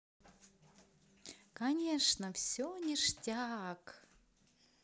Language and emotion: Russian, positive